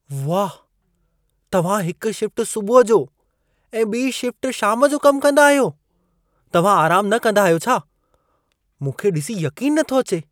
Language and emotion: Sindhi, surprised